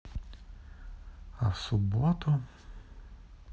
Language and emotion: Russian, neutral